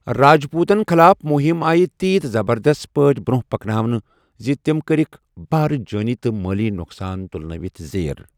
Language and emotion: Kashmiri, neutral